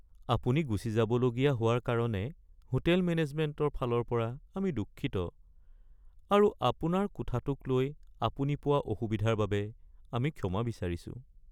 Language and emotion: Assamese, sad